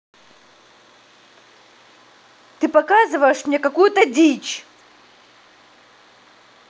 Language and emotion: Russian, angry